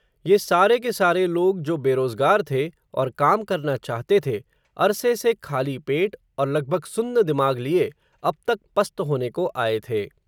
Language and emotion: Hindi, neutral